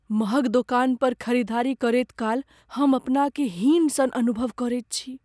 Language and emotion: Maithili, fearful